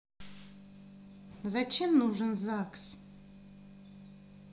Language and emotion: Russian, neutral